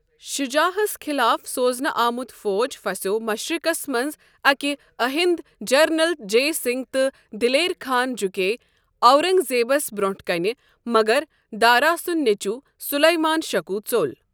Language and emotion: Kashmiri, neutral